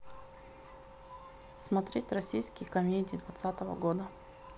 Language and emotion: Russian, neutral